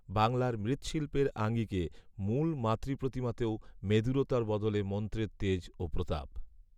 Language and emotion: Bengali, neutral